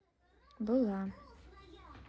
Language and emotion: Russian, neutral